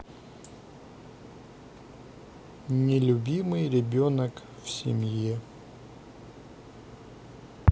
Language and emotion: Russian, sad